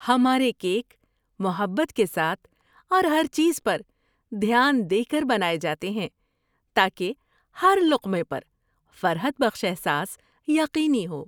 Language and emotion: Urdu, happy